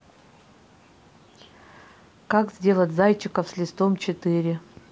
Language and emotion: Russian, neutral